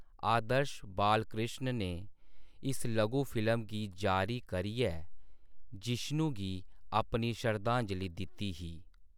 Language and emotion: Dogri, neutral